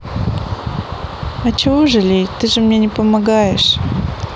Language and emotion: Russian, sad